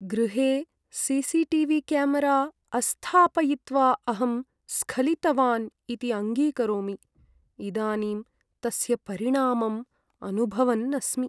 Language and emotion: Sanskrit, sad